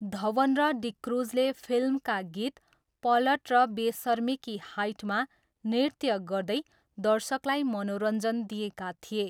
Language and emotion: Nepali, neutral